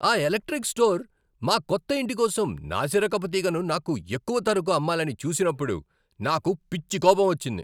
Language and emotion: Telugu, angry